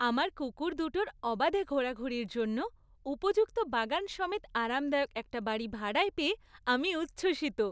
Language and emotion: Bengali, happy